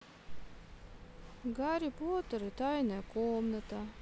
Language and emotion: Russian, neutral